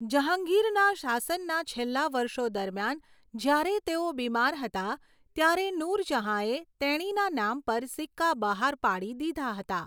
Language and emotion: Gujarati, neutral